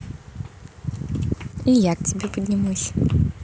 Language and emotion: Russian, positive